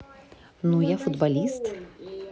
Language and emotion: Russian, neutral